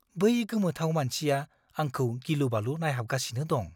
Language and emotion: Bodo, fearful